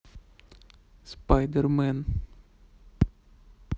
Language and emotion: Russian, neutral